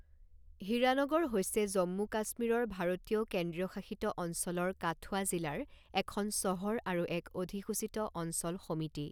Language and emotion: Assamese, neutral